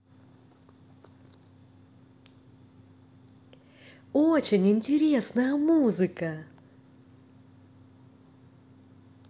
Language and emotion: Russian, positive